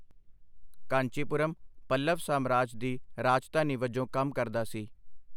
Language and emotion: Punjabi, neutral